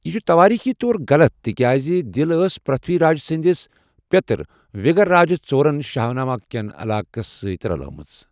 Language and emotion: Kashmiri, neutral